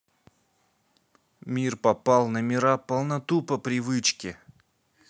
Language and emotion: Russian, neutral